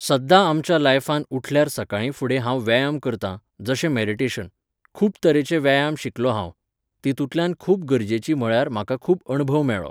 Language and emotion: Goan Konkani, neutral